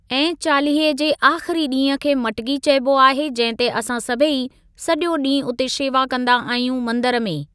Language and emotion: Sindhi, neutral